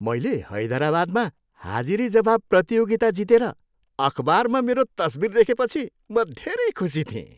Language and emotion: Nepali, happy